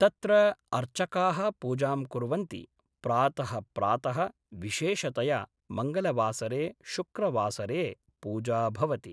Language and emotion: Sanskrit, neutral